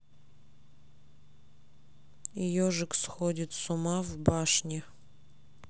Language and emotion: Russian, neutral